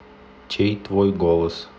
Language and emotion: Russian, neutral